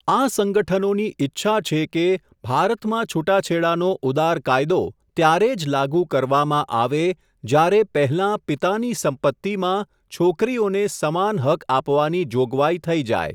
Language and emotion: Gujarati, neutral